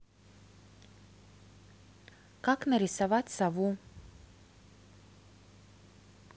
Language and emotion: Russian, neutral